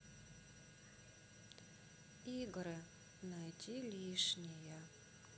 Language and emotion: Russian, sad